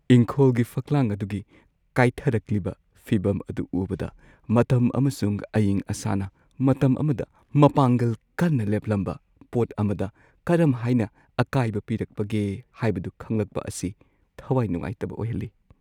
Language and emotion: Manipuri, sad